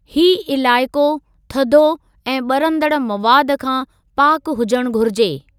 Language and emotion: Sindhi, neutral